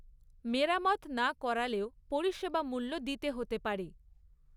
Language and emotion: Bengali, neutral